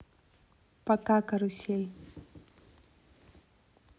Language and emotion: Russian, neutral